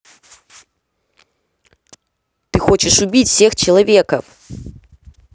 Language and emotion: Russian, neutral